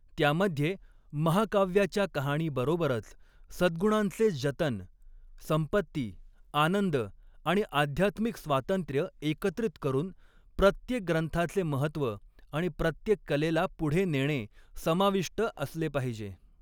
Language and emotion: Marathi, neutral